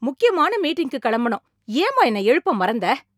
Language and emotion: Tamil, angry